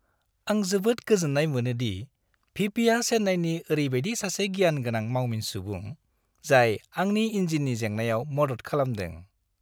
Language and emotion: Bodo, happy